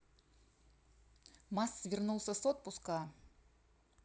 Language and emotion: Russian, neutral